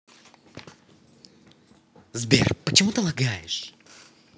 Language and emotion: Russian, angry